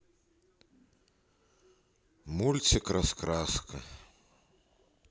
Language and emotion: Russian, sad